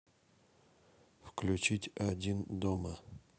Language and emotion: Russian, neutral